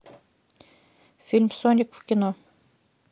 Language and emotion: Russian, neutral